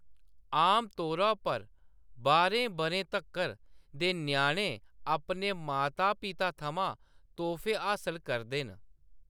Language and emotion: Dogri, neutral